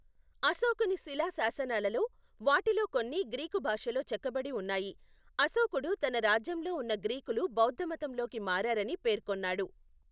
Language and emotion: Telugu, neutral